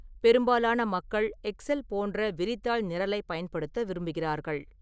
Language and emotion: Tamil, neutral